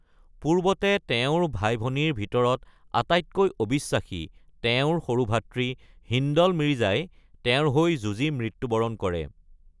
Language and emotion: Assamese, neutral